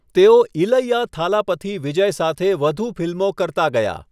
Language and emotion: Gujarati, neutral